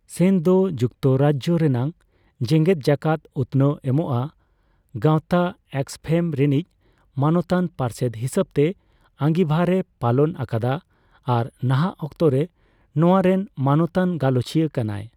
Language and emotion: Santali, neutral